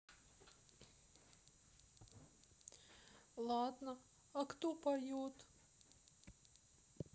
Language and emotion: Russian, sad